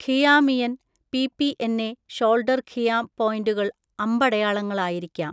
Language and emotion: Malayalam, neutral